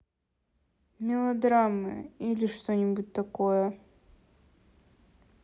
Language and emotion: Russian, neutral